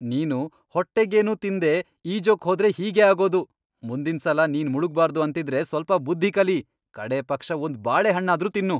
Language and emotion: Kannada, angry